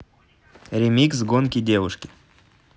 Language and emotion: Russian, neutral